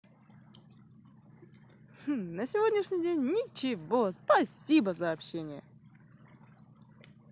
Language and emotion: Russian, positive